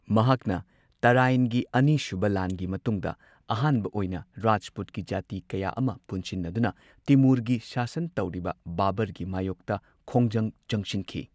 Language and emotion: Manipuri, neutral